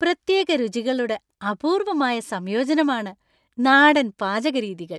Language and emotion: Malayalam, happy